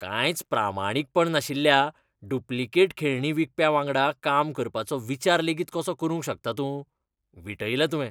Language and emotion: Goan Konkani, disgusted